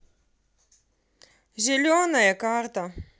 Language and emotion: Russian, neutral